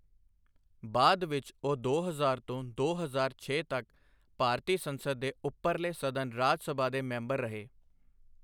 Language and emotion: Punjabi, neutral